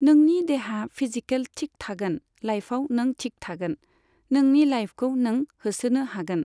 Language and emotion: Bodo, neutral